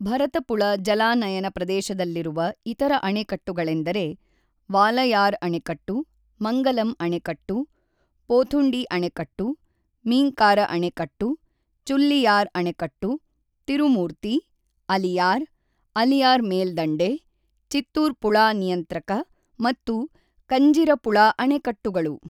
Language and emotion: Kannada, neutral